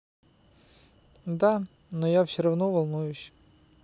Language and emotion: Russian, sad